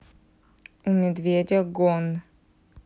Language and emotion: Russian, neutral